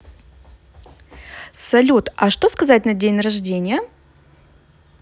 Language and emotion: Russian, positive